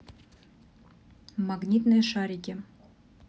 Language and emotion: Russian, neutral